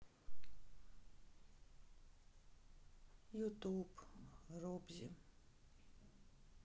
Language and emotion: Russian, sad